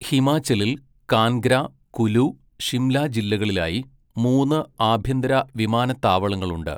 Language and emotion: Malayalam, neutral